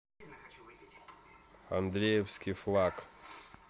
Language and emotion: Russian, neutral